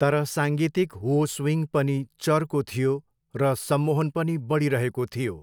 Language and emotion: Nepali, neutral